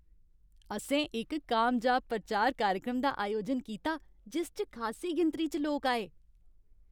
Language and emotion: Dogri, happy